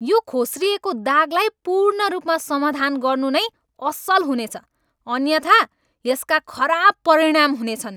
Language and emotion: Nepali, angry